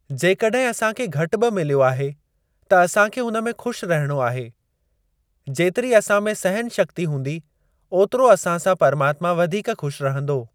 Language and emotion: Sindhi, neutral